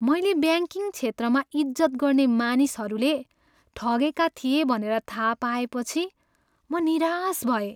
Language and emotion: Nepali, sad